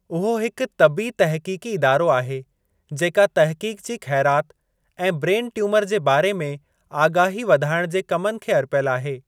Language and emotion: Sindhi, neutral